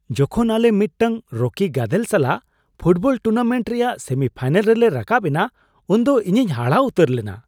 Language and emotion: Santali, surprised